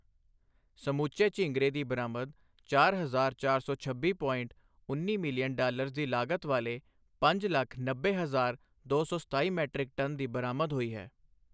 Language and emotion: Punjabi, neutral